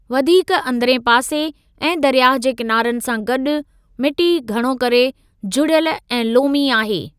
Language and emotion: Sindhi, neutral